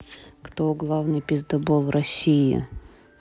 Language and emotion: Russian, neutral